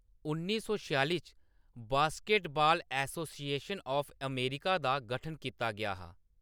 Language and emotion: Dogri, neutral